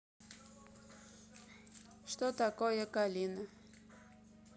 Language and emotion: Russian, neutral